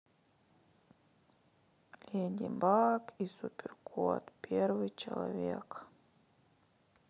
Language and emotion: Russian, sad